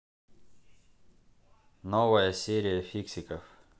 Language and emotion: Russian, neutral